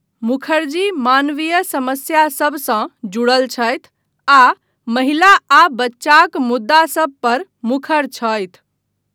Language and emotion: Maithili, neutral